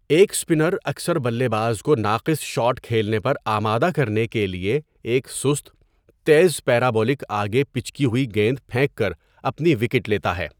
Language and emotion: Urdu, neutral